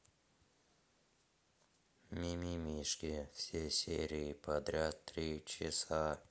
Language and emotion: Russian, neutral